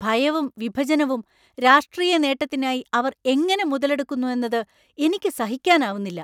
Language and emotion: Malayalam, angry